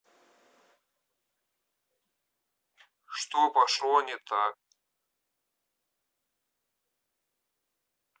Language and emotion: Russian, neutral